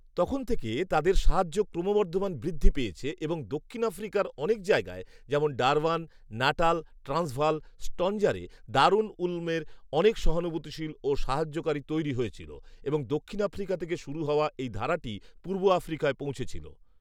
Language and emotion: Bengali, neutral